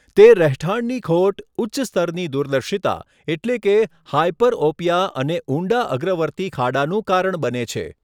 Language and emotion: Gujarati, neutral